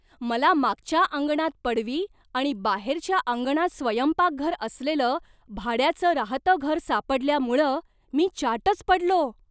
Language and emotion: Marathi, surprised